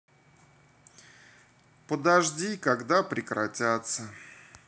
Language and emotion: Russian, neutral